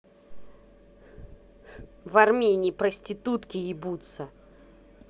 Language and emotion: Russian, angry